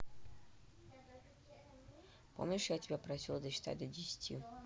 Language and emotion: Russian, neutral